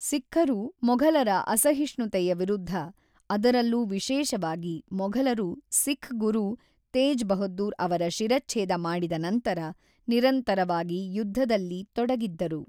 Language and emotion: Kannada, neutral